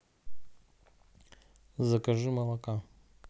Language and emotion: Russian, neutral